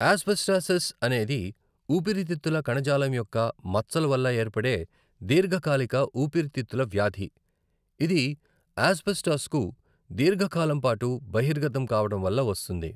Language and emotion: Telugu, neutral